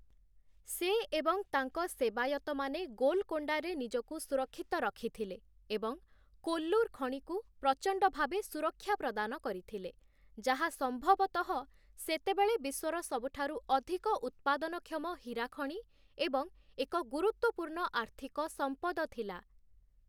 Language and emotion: Odia, neutral